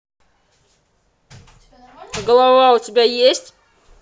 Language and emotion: Russian, angry